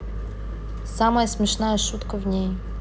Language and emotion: Russian, neutral